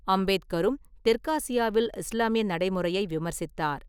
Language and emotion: Tamil, neutral